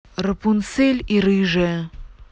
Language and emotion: Russian, neutral